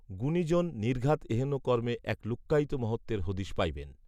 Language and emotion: Bengali, neutral